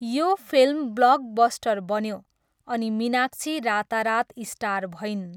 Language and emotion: Nepali, neutral